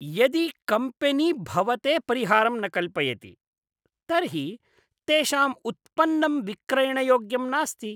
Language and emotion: Sanskrit, disgusted